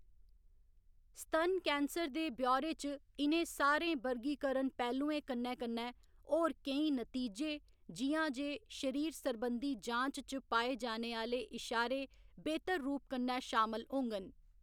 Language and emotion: Dogri, neutral